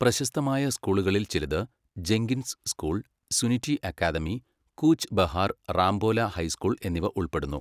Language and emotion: Malayalam, neutral